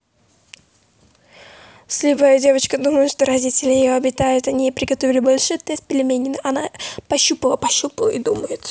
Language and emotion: Russian, neutral